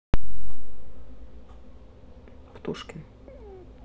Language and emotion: Russian, neutral